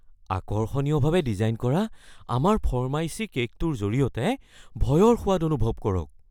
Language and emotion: Assamese, fearful